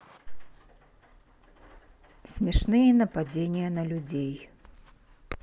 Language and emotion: Russian, neutral